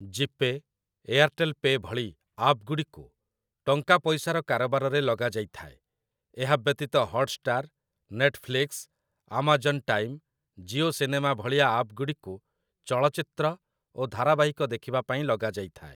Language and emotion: Odia, neutral